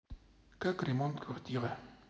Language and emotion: Russian, neutral